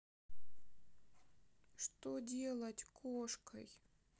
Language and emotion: Russian, sad